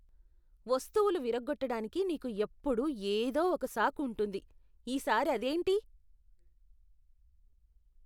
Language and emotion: Telugu, disgusted